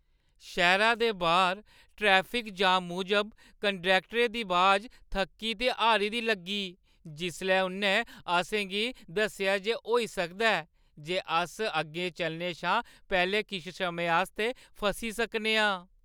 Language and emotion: Dogri, sad